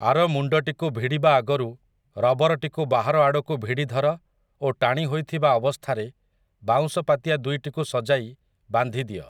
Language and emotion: Odia, neutral